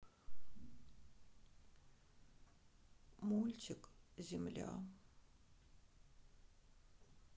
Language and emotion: Russian, sad